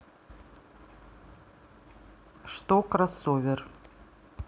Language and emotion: Russian, neutral